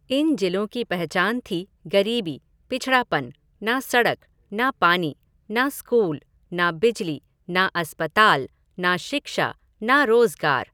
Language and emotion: Hindi, neutral